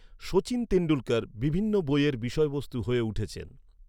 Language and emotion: Bengali, neutral